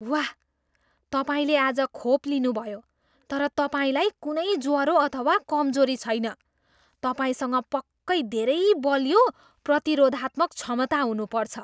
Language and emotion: Nepali, surprised